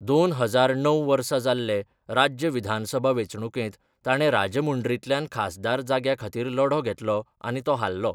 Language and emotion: Goan Konkani, neutral